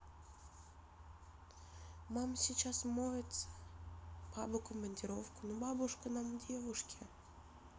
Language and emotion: Russian, sad